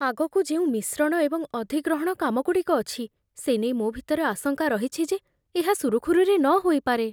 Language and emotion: Odia, fearful